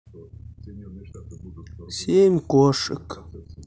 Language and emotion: Russian, neutral